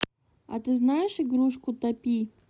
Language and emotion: Russian, neutral